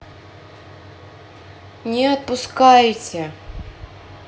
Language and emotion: Russian, sad